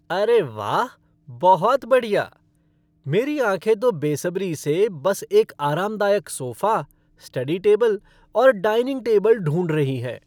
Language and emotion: Hindi, happy